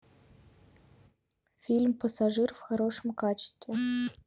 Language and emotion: Russian, neutral